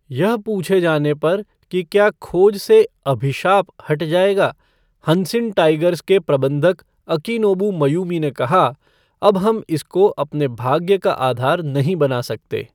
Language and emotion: Hindi, neutral